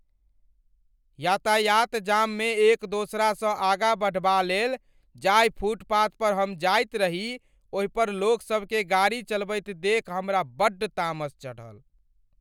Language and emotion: Maithili, angry